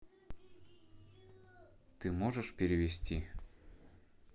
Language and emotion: Russian, neutral